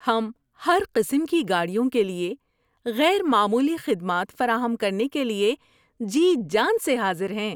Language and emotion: Urdu, happy